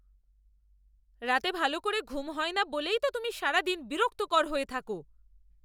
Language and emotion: Bengali, angry